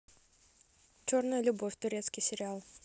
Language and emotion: Russian, neutral